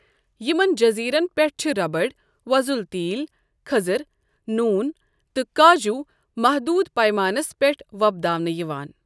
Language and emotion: Kashmiri, neutral